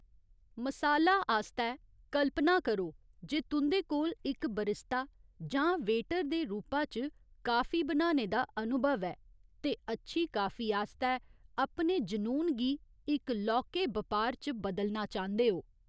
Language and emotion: Dogri, neutral